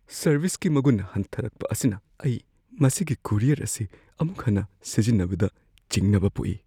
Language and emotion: Manipuri, fearful